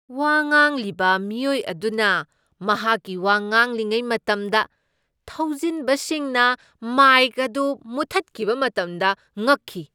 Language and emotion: Manipuri, surprised